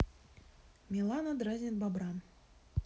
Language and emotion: Russian, neutral